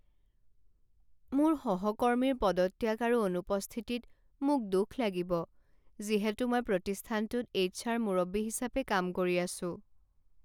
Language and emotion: Assamese, sad